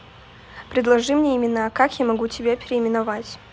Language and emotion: Russian, neutral